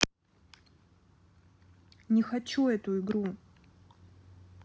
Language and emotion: Russian, angry